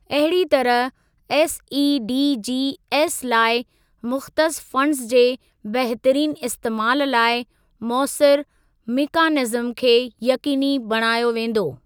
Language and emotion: Sindhi, neutral